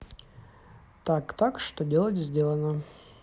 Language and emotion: Russian, neutral